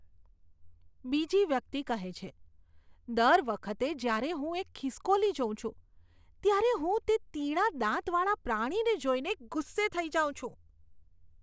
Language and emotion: Gujarati, disgusted